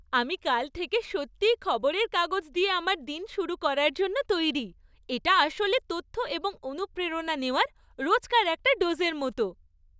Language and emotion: Bengali, happy